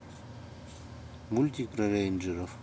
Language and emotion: Russian, neutral